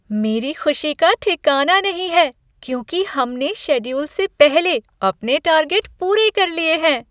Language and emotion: Hindi, happy